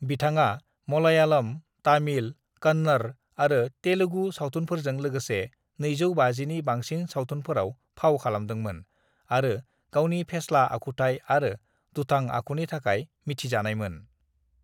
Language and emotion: Bodo, neutral